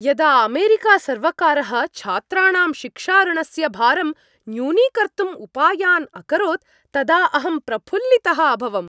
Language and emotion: Sanskrit, happy